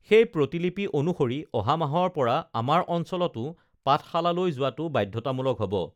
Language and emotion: Assamese, neutral